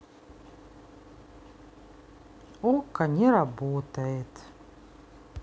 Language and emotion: Russian, sad